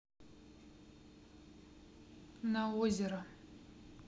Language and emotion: Russian, neutral